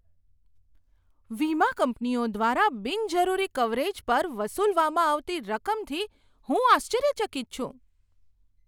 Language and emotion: Gujarati, surprised